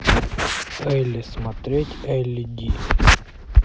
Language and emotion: Russian, neutral